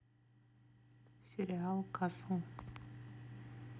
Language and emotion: Russian, neutral